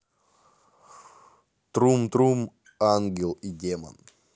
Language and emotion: Russian, neutral